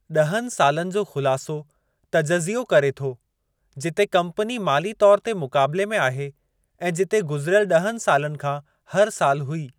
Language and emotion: Sindhi, neutral